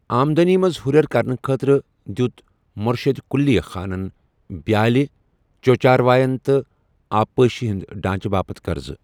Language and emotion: Kashmiri, neutral